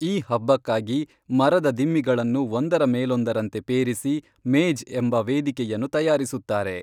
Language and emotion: Kannada, neutral